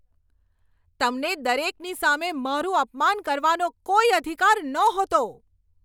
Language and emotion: Gujarati, angry